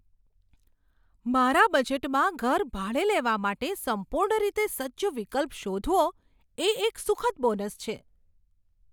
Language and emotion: Gujarati, surprised